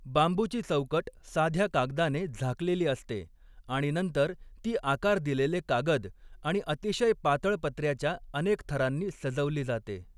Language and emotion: Marathi, neutral